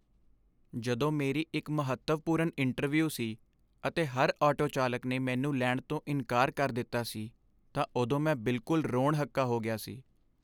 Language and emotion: Punjabi, sad